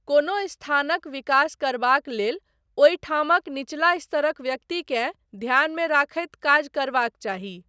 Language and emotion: Maithili, neutral